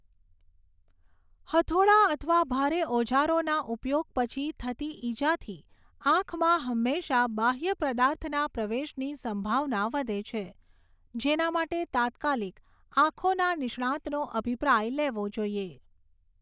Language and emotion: Gujarati, neutral